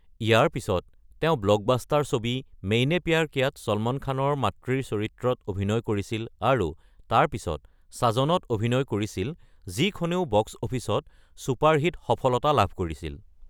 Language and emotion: Assamese, neutral